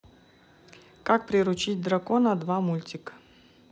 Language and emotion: Russian, neutral